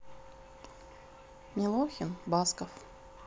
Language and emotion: Russian, neutral